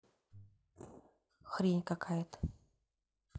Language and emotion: Russian, neutral